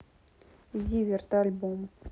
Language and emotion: Russian, neutral